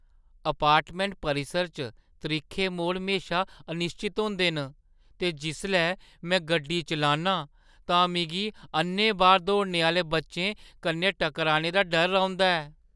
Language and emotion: Dogri, fearful